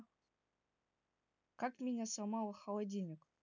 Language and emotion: Russian, neutral